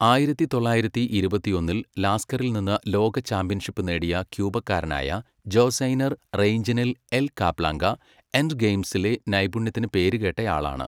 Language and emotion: Malayalam, neutral